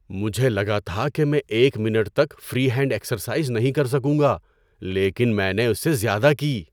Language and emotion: Urdu, surprised